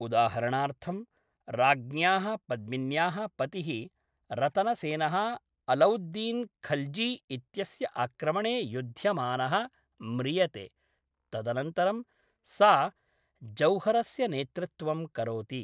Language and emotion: Sanskrit, neutral